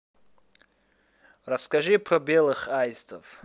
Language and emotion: Russian, neutral